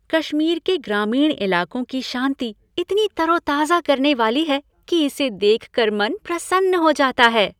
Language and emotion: Hindi, happy